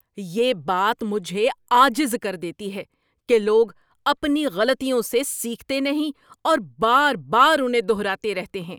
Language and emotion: Urdu, angry